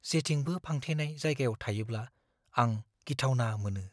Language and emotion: Bodo, fearful